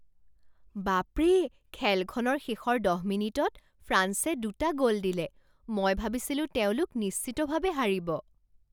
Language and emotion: Assamese, surprised